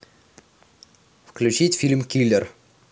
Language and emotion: Russian, neutral